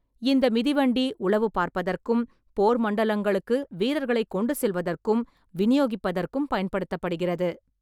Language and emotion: Tamil, neutral